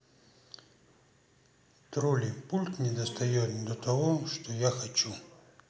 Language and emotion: Russian, neutral